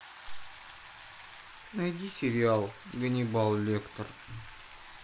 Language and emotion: Russian, sad